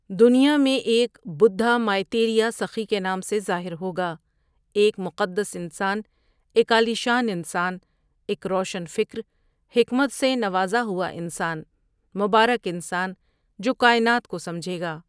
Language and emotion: Urdu, neutral